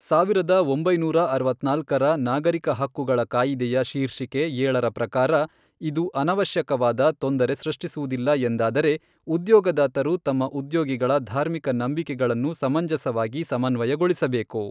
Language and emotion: Kannada, neutral